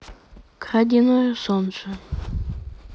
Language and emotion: Russian, neutral